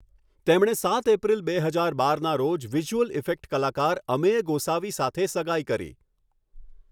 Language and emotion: Gujarati, neutral